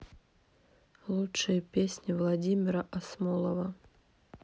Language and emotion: Russian, neutral